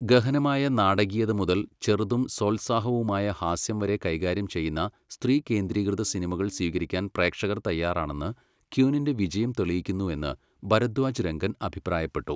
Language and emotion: Malayalam, neutral